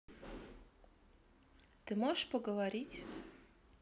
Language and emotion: Russian, neutral